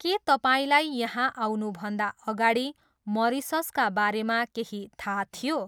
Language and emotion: Nepali, neutral